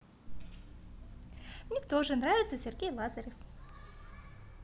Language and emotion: Russian, positive